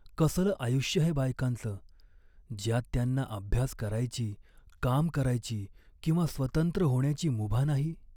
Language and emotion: Marathi, sad